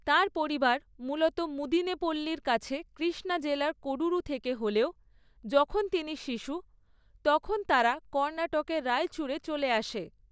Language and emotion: Bengali, neutral